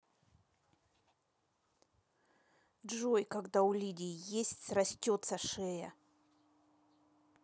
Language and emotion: Russian, neutral